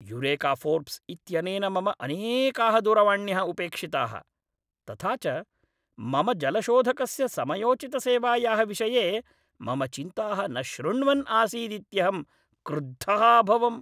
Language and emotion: Sanskrit, angry